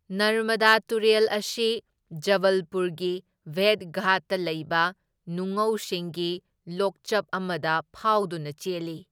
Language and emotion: Manipuri, neutral